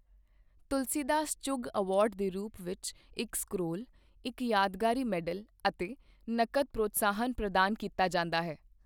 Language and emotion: Punjabi, neutral